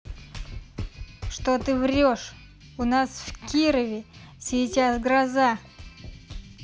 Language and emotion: Russian, angry